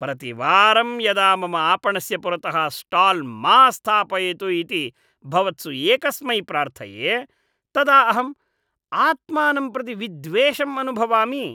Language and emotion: Sanskrit, disgusted